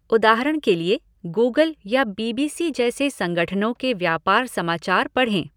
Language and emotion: Hindi, neutral